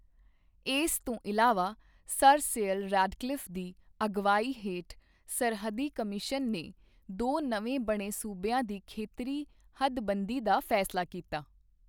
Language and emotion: Punjabi, neutral